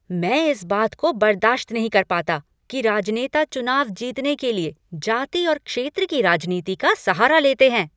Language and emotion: Hindi, angry